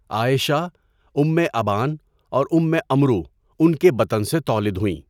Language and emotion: Urdu, neutral